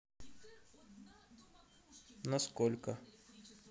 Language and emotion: Russian, neutral